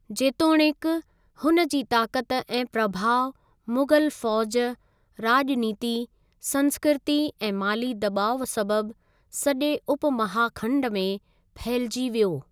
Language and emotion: Sindhi, neutral